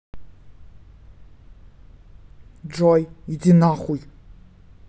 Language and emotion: Russian, angry